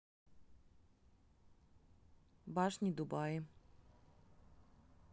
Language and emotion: Russian, neutral